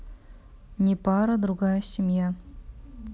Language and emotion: Russian, neutral